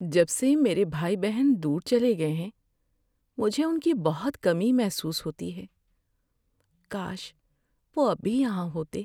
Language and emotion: Urdu, sad